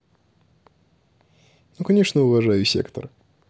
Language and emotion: Russian, neutral